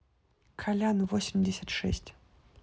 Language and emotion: Russian, neutral